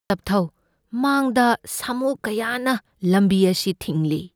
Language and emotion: Manipuri, fearful